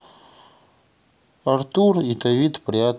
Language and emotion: Russian, neutral